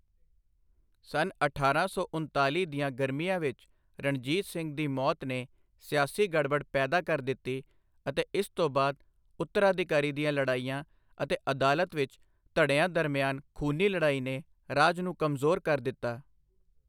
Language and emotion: Punjabi, neutral